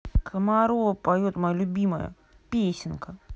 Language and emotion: Russian, angry